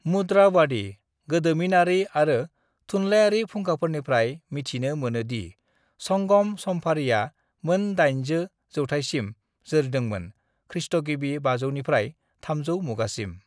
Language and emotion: Bodo, neutral